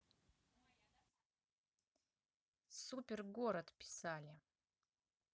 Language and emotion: Russian, neutral